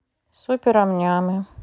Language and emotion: Russian, neutral